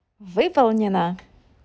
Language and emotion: Russian, positive